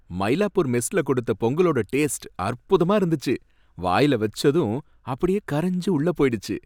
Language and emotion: Tamil, happy